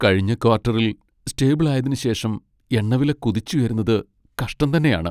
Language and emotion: Malayalam, sad